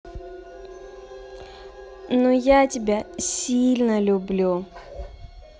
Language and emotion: Russian, positive